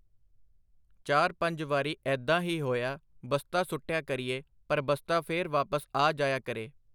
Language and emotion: Punjabi, neutral